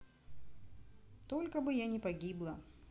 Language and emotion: Russian, neutral